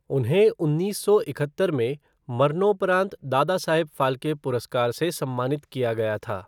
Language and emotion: Hindi, neutral